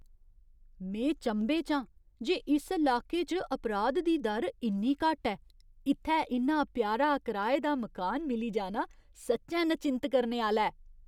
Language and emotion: Dogri, surprised